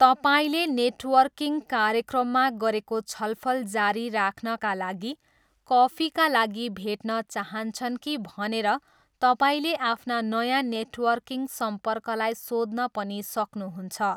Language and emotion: Nepali, neutral